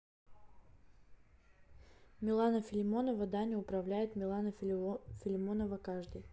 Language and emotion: Russian, neutral